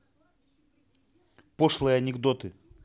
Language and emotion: Russian, neutral